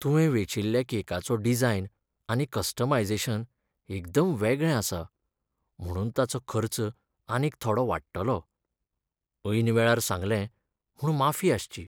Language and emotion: Goan Konkani, sad